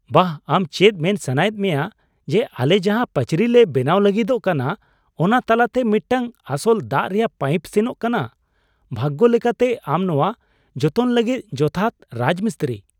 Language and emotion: Santali, surprised